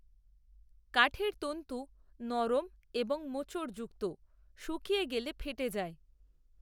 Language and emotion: Bengali, neutral